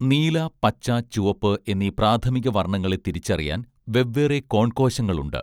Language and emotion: Malayalam, neutral